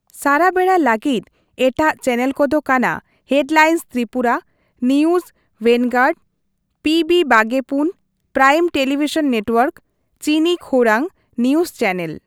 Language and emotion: Santali, neutral